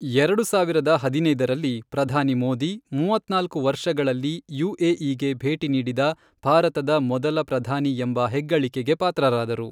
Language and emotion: Kannada, neutral